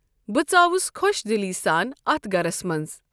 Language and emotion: Kashmiri, neutral